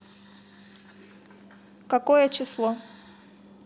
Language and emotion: Russian, neutral